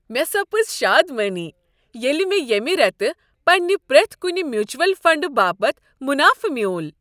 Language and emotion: Kashmiri, happy